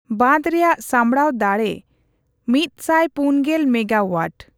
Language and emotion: Santali, neutral